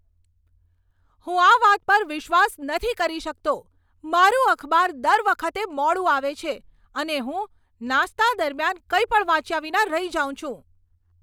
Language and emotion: Gujarati, angry